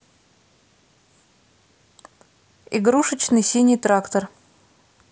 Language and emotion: Russian, neutral